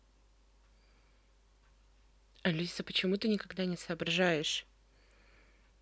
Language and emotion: Russian, angry